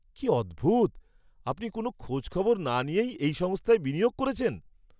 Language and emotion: Bengali, surprised